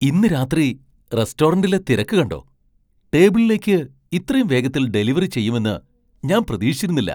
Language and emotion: Malayalam, surprised